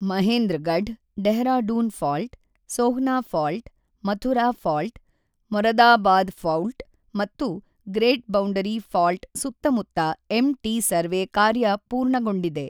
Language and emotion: Kannada, neutral